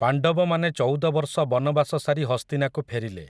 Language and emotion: Odia, neutral